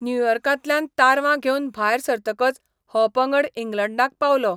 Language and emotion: Goan Konkani, neutral